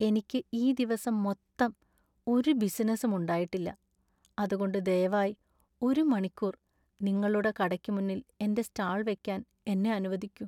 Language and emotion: Malayalam, sad